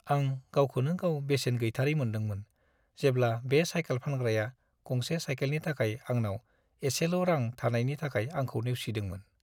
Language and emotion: Bodo, sad